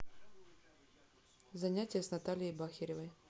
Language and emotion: Russian, neutral